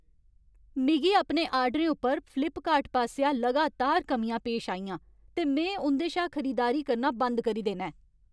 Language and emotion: Dogri, angry